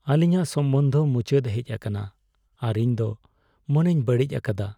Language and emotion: Santali, sad